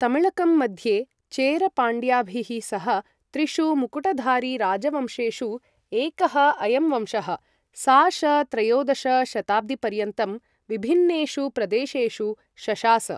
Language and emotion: Sanskrit, neutral